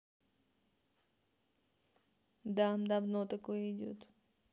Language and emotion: Russian, neutral